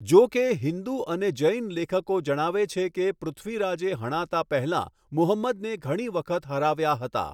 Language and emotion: Gujarati, neutral